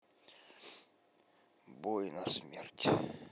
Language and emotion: Russian, sad